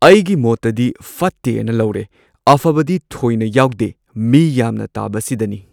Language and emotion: Manipuri, neutral